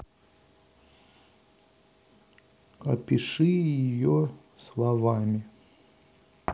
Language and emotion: Russian, sad